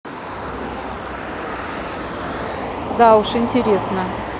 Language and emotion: Russian, neutral